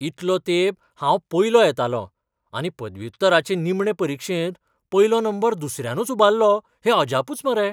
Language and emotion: Goan Konkani, surprised